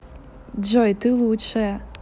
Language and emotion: Russian, positive